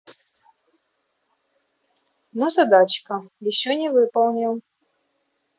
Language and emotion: Russian, neutral